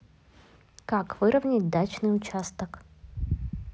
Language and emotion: Russian, neutral